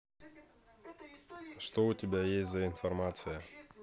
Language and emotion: Russian, neutral